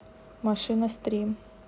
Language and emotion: Russian, neutral